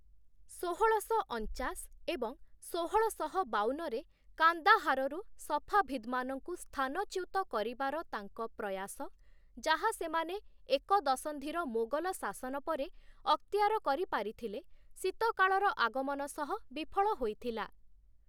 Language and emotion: Odia, neutral